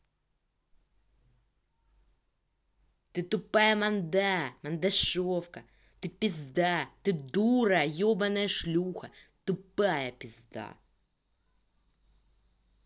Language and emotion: Russian, angry